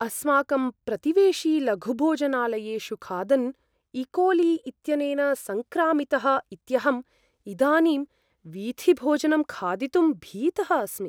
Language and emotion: Sanskrit, fearful